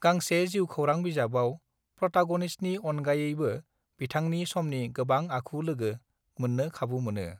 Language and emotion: Bodo, neutral